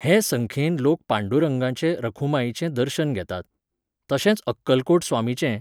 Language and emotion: Goan Konkani, neutral